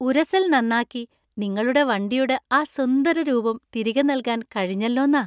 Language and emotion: Malayalam, happy